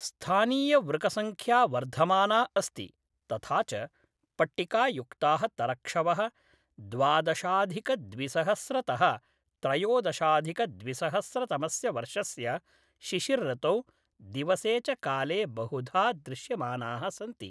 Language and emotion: Sanskrit, neutral